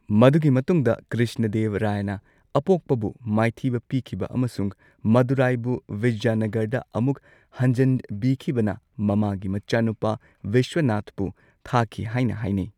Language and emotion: Manipuri, neutral